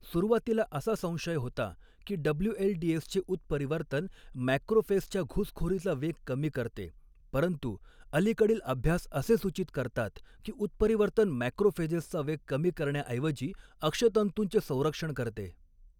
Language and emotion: Marathi, neutral